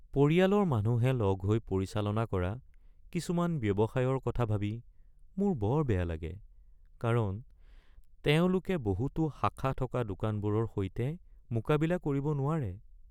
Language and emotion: Assamese, sad